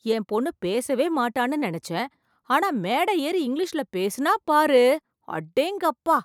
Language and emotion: Tamil, surprised